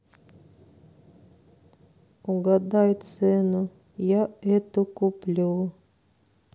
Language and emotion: Russian, sad